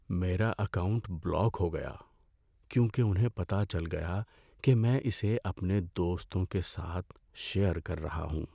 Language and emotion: Urdu, sad